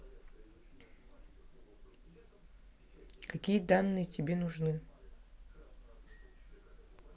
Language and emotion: Russian, neutral